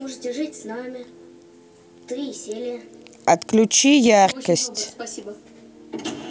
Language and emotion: Russian, neutral